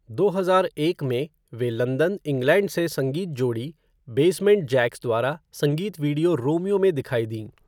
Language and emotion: Hindi, neutral